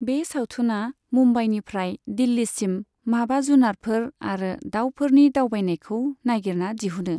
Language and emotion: Bodo, neutral